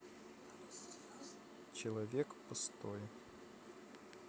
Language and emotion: Russian, sad